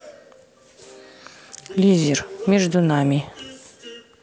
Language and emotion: Russian, neutral